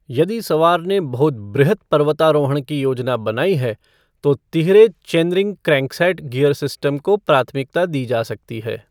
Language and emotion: Hindi, neutral